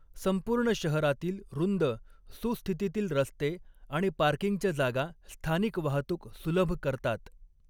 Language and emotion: Marathi, neutral